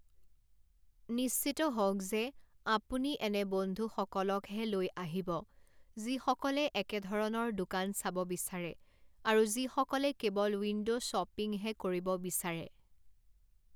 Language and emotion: Assamese, neutral